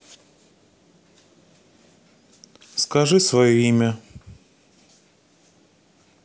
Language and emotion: Russian, neutral